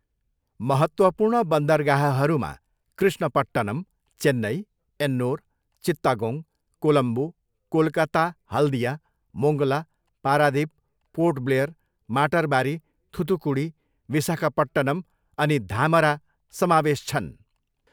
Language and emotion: Nepali, neutral